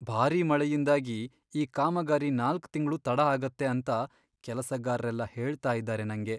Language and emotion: Kannada, sad